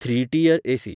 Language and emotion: Goan Konkani, neutral